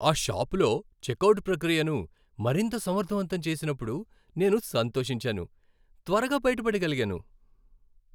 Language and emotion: Telugu, happy